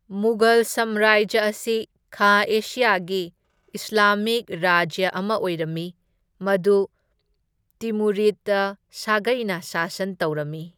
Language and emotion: Manipuri, neutral